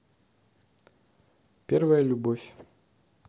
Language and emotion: Russian, neutral